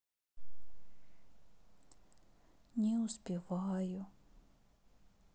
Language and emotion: Russian, sad